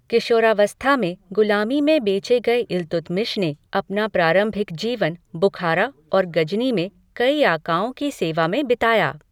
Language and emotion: Hindi, neutral